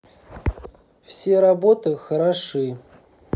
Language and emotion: Russian, neutral